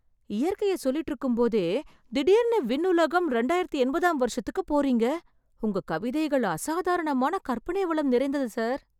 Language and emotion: Tamil, surprised